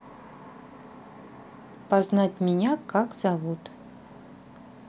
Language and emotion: Russian, neutral